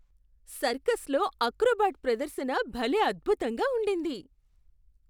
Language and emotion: Telugu, surprised